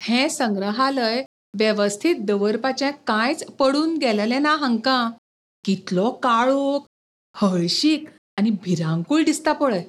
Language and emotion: Goan Konkani, disgusted